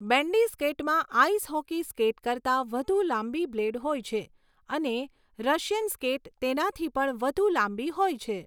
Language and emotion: Gujarati, neutral